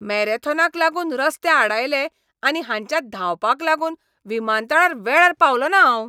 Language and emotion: Goan Konkani, angry